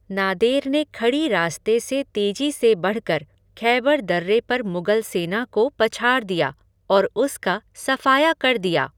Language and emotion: Hindi, neutral